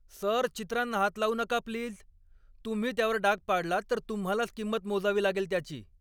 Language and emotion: Marathi, angry